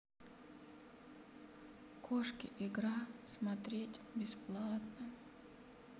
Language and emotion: Russian, sad